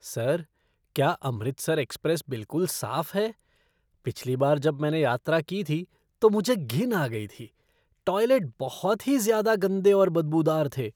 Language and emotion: Hindi, disgusted